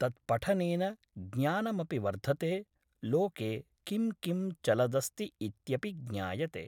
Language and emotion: Sanskrit, neutral